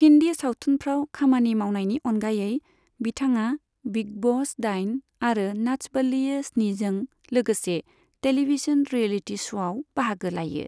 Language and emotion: Bodo, neutral